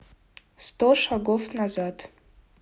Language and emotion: Russian, neutral